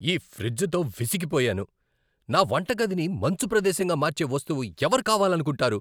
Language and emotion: Telugu, angry